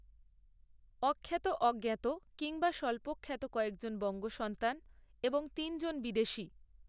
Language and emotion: Bengali, neutral